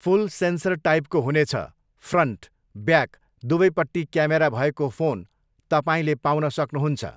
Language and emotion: Nepali, neutral